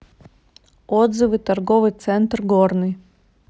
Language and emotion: Russian, neutral